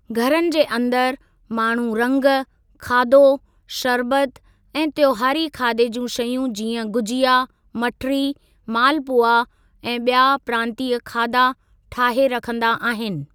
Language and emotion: Sindhi, neutral